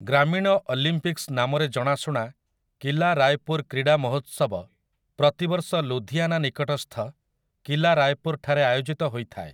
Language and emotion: Odia, neutral